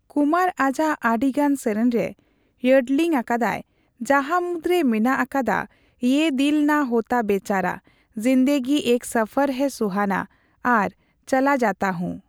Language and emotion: Santali, neutral